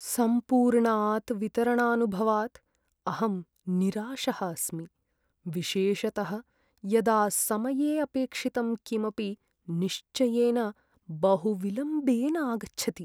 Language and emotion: Sanskrit, sad